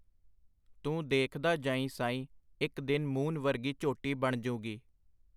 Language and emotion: Punjabi, neutral